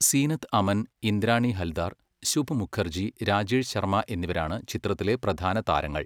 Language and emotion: Malayalam, neutral